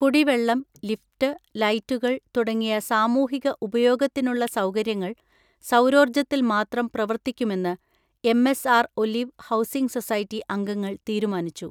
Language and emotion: Malayalam, neutral